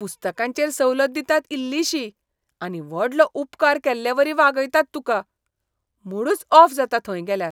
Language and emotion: Goan Konkani, disgusted